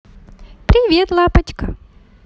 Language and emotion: Russian, positive